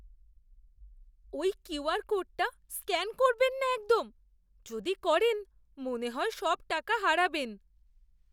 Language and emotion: Bengali, fearful